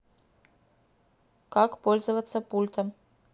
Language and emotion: Russian, neutral